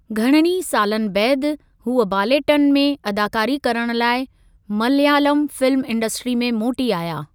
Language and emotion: Sindhi, neutral